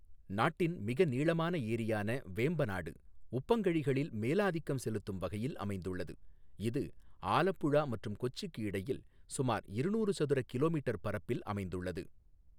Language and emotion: Tamil, neutral